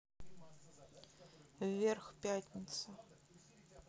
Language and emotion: Russian, neutral